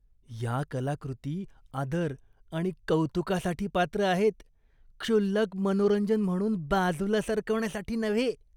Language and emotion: Marathi, disgusted